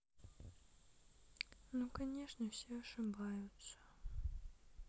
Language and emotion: Russian, sad